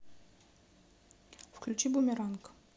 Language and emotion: Russian, neutral